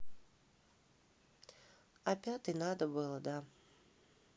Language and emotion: Russian, neutral